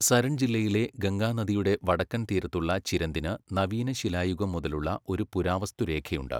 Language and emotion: Malayalam, neutral